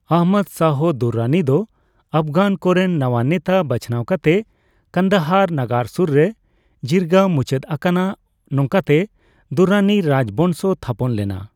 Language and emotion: Santali, neutral